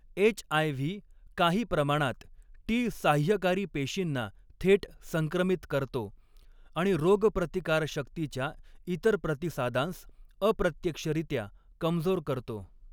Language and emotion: Marathi, neutral